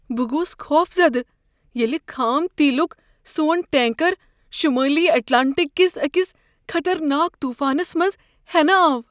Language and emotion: Kashmiri, fearful